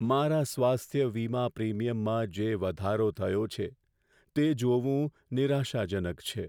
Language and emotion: Gujarati, sad